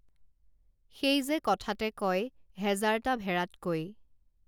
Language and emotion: Assamese, neutral